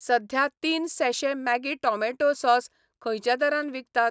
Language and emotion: Goan Konkani, neutral